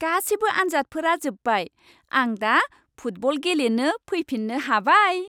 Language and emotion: Bodo, happy